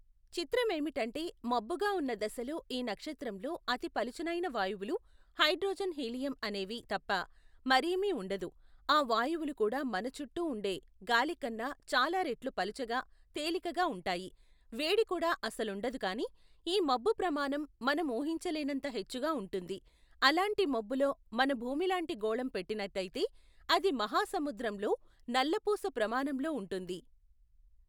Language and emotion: Telugu, neutral